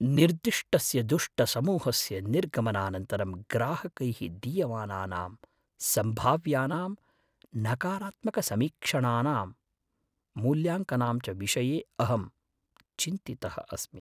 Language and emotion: Sanskrit, fearful